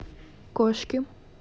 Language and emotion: Russian, neutral